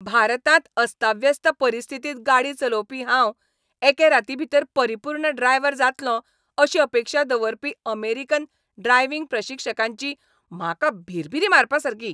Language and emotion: Goan Konkani, angry